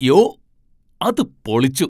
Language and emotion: Malayalam, surprised